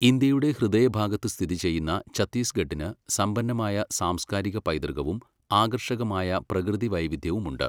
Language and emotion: Malayalam, neutral